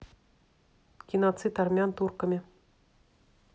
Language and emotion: Russian, neutral